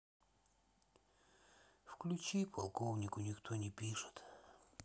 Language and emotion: Russian, sad